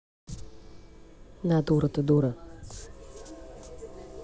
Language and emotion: Russian, neutral